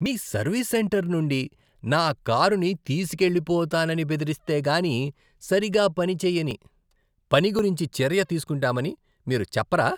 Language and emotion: Telugu, disgusted